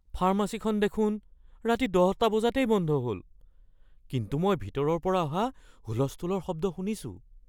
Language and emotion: Assamese, fearful